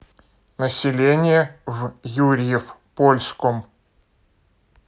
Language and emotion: Russian, neutral